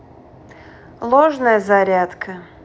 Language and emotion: Russian, neutral